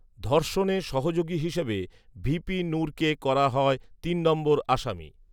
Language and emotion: Bengali, neutral